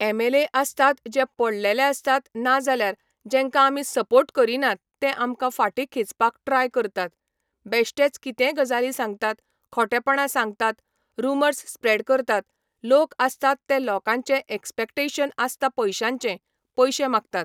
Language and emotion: Goan Konkani, neutral